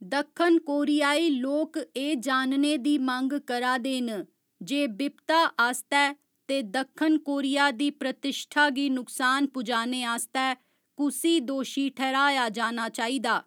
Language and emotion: Dogri, neutral